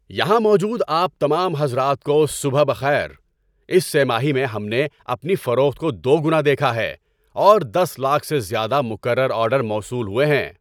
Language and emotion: Urdu, happy